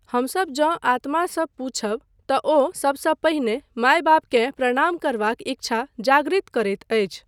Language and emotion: Maithili, neutral